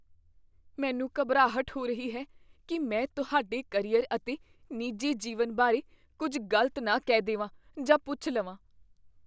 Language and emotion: Punjabi, fearful